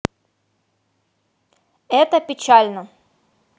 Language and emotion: Russian, positive